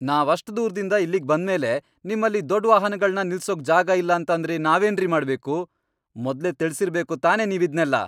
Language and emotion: Kannada, angry